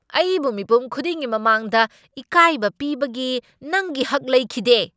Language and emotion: Manipuri, angry